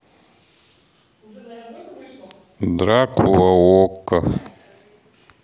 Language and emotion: Russian, neutral